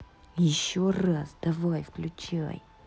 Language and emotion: Russian, angry